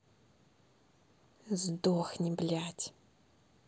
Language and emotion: Russian, angry